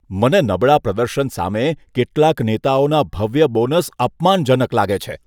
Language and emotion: Gujarati, disgusted